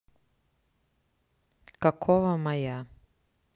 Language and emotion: Russian, neutral